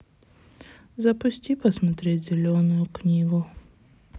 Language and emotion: Russian, sad